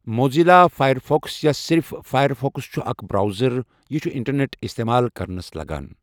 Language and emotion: Kashmiri, neutral